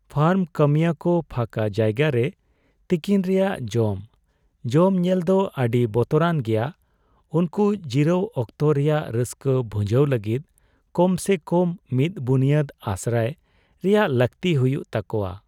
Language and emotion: Santali, sad